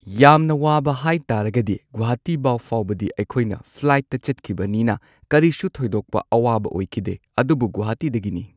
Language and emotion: Manipuri, neutral